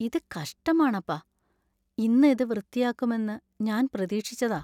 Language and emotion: Malayalam, sad